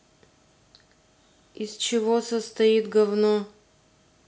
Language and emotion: Russian, neutral